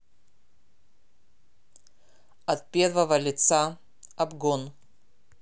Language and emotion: Russian, neutral